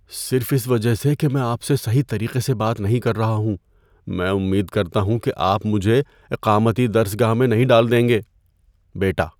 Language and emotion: Urdu, fearful